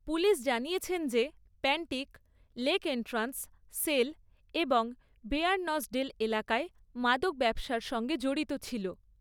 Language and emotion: Bengali, neutral